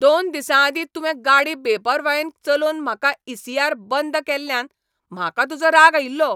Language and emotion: Goan Konkani, angry